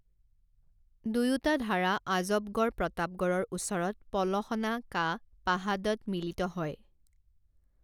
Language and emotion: Assamese, neutral